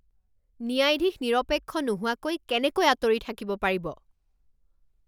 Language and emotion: Assamese, angry